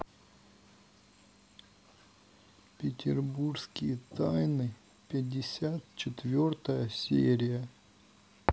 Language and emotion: Russian, sad